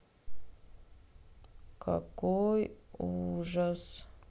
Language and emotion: Russian, sad